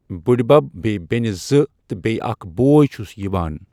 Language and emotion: Kashmiri, neutral